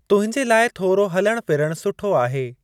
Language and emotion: Sindhi, neutral